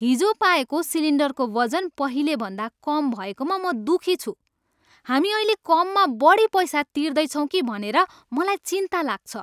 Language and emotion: Nepali, angry